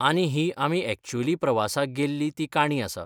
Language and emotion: Goan Konkani, neutral